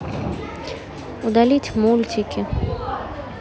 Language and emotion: Russian, neutral